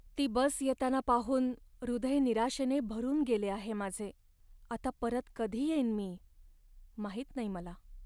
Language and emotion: Marathi, sad